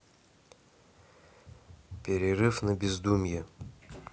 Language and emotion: Russian, neutral